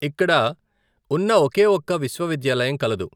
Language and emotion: Telugu, neutral